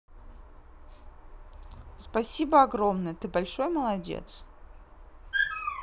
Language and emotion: Russian, positive